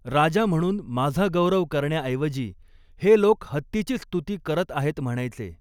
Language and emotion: Marathi, neutral